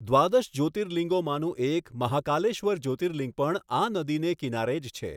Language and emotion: Gujarati, neutral